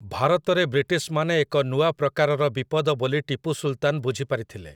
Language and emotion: Odia, neutral